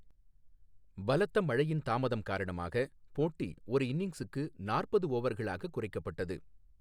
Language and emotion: Tamil, neutral